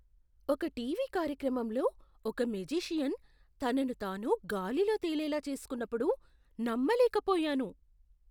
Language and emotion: Telugu, surprised